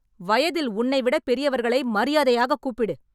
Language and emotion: Tamil, angry